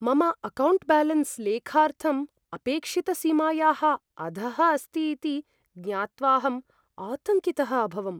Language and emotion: Sanskrit, fearful